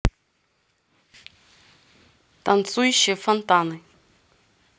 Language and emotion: Russian, neutral